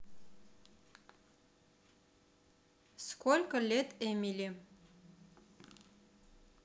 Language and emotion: Russian, neutral